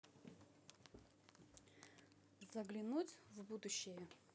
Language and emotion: Russian, neutral